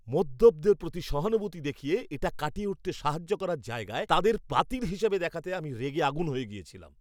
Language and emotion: Bengali, angry